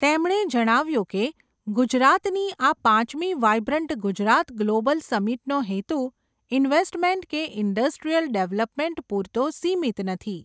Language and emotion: Gujarati, neutral